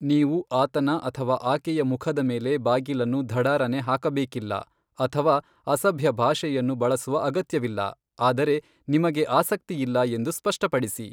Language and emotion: Kannada, neutral